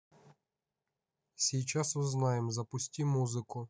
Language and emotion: Russian, neutral